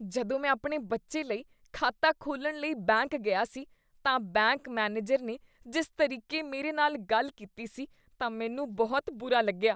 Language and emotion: Punjabi, disgusted